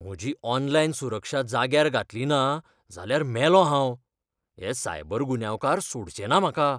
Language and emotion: Goan Konkani, fearful